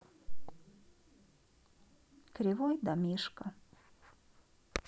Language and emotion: Russian, sad